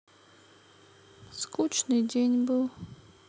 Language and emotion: Russian, sad